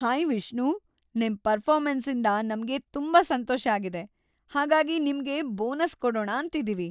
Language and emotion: Kannada, happy